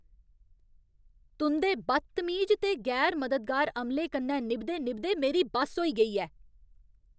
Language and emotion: Dogri, angry